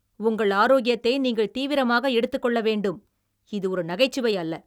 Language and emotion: Tamil, angry